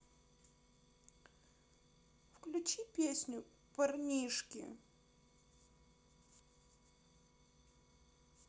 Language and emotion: Russian, sad